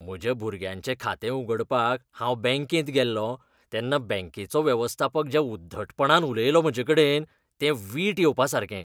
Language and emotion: Goan Konkani, disgusted